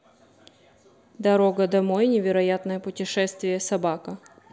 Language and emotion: Russian, neutral